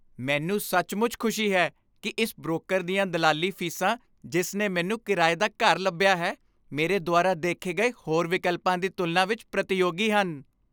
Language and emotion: Punjabi, happy